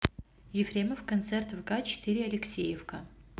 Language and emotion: Russian, neutral